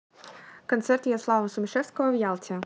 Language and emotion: Russian, neutral